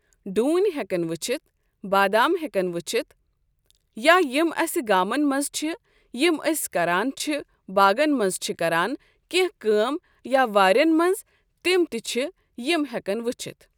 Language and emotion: Kashmiri, neutral